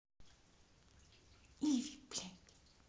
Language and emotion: Russian, angry